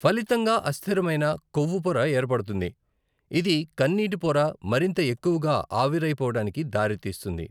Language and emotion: Telugu, neutral